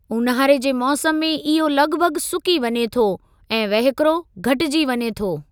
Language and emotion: Sindhi, neutral